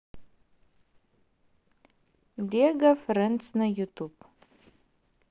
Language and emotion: Russian, neutral